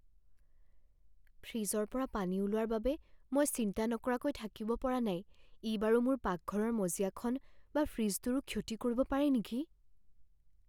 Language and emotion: Assamese, fearful